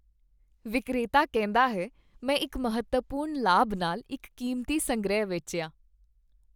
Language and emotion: Punjabi, happy